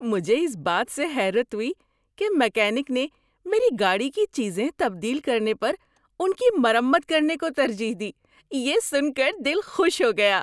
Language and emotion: Urdu, surprised